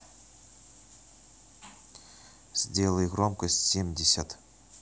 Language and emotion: Russian, neutral